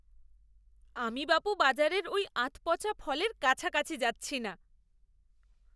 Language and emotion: Bengali, disgusted